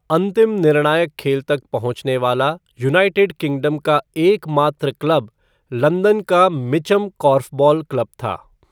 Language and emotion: Hindi, neutral